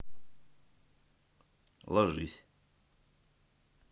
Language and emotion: Russian, neutral